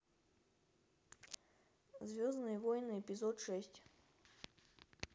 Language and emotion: Russian, neutral